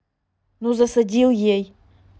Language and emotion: Russian, angry